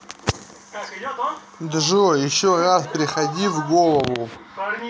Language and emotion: Russian, angry